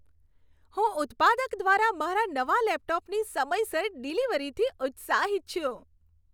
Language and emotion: Gujarati, happy